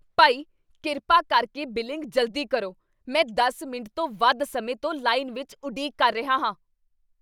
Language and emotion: Punjabi, angry